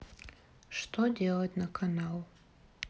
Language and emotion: Russian, sad